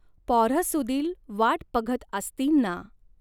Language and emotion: Marathi, neutral